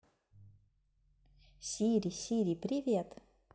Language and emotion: Russian, positive